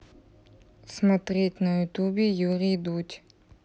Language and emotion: Russian, neutral